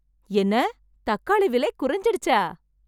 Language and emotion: Tamil, happy